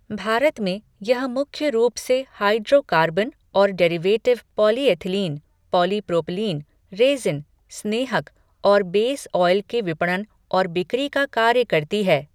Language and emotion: Hindi, neutral